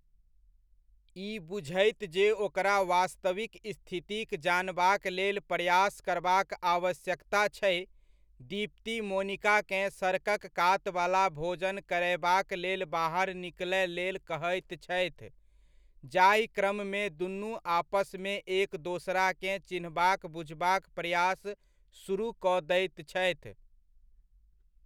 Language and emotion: Maithili, neutral